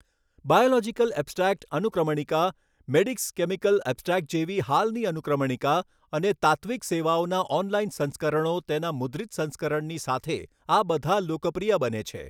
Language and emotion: Gujarati, neutral